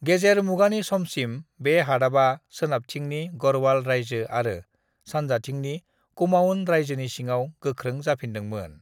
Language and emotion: Bodo, neutral